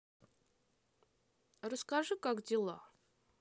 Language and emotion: Russian, neutral